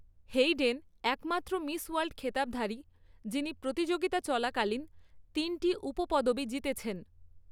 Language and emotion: Bengali, neutral